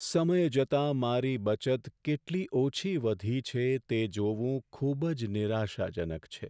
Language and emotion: Gujarati, sad